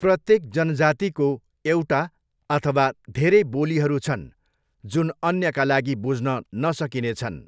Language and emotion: Nepali, neutral